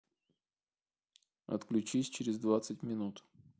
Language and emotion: Russian, neutral